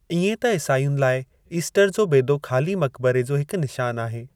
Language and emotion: Sindhi, neutral